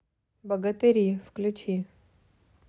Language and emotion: Russian, neutral